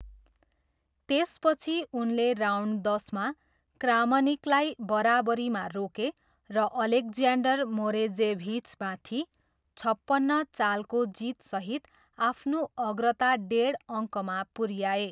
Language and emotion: Nepali, neutral